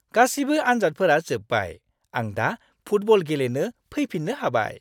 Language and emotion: Bodo, happy